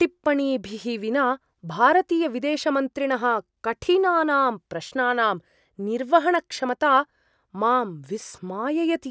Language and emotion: Sanskrit, surprised